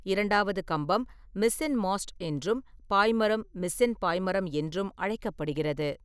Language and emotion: Tamil, neutral